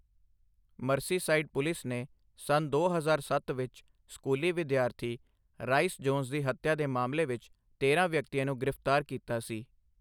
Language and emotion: Punjabi, neutral